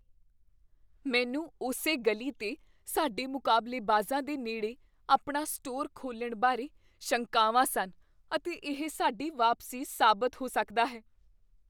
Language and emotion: Punjabi, fearful